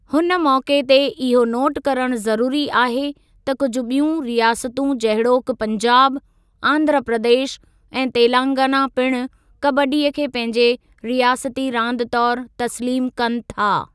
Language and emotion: Sindhi, neutral